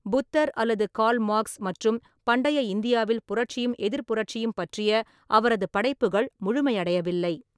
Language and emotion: Tamil, neutral